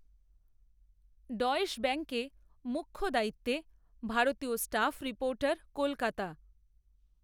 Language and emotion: Bengali, neutral